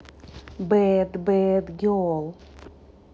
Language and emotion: Russian, positive